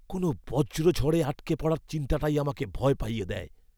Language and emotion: Bengali, fearful